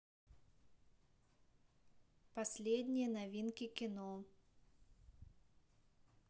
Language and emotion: Russian, neutral